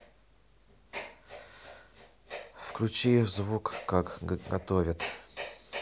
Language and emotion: Russian, neutral